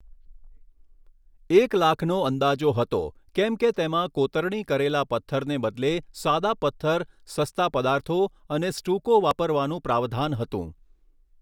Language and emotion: Gujarati, neutral